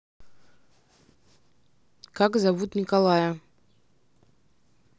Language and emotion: Russian, neutral